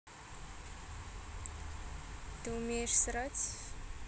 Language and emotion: Russian, neutral